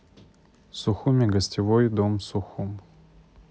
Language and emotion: Russian, neutral